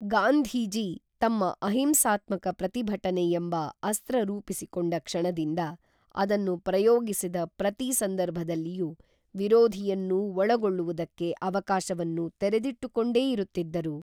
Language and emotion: Kannada, neutral